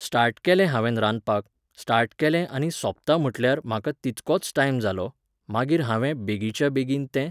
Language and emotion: Goan Konkani, neutral